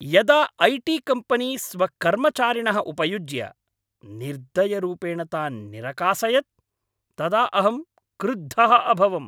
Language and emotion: Sanskrit, angry